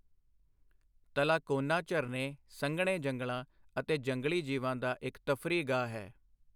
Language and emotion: Punjabi, neutral